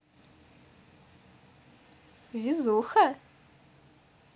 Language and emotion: Russian, positive